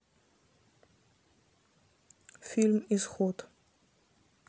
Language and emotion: Russian, neutral